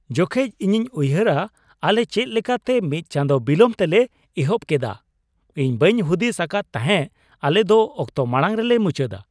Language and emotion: Santali, surprised